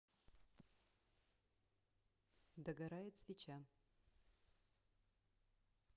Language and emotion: Russian, neutral